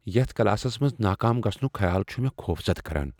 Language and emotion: Kashmiri, fearful